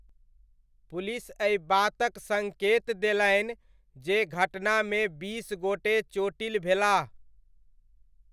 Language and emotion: Maithili, neutral